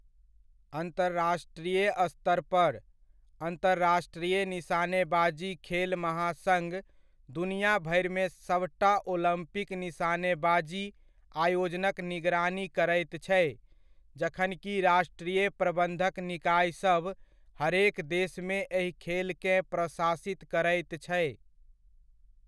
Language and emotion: Maithili, neutral